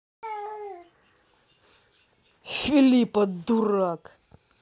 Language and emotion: Russian, angry